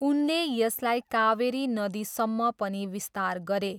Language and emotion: Nepali, neutral